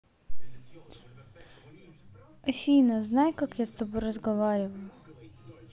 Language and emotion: Russian, neutral